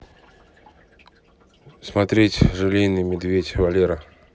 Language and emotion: Russian, neutral